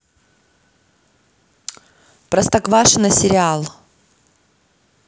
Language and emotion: Russian, neutral